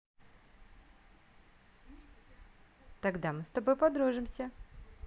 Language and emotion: Russian, positive